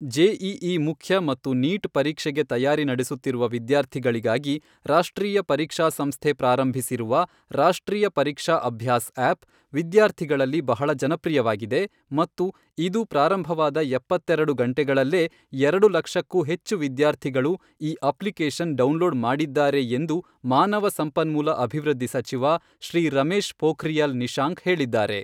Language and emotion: Kannada, neutral